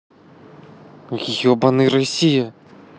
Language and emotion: Russian, angry